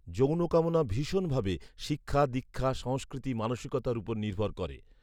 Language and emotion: Bengali, neutral